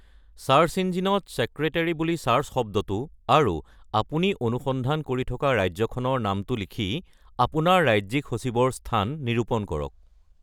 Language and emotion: Assamese, neutral